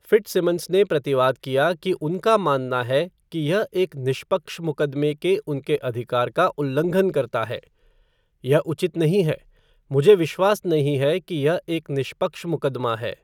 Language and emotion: Hindi, neutral